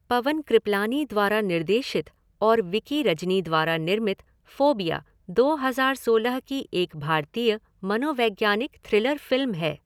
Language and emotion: Hindi, neutral